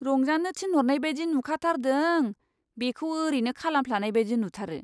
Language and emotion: Bodo, disgusted